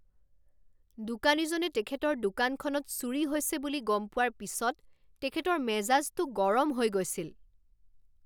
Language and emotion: Assamese, angry